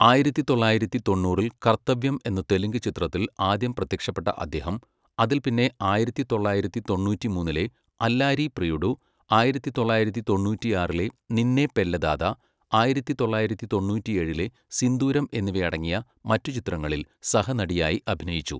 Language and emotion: Malayalam, neutral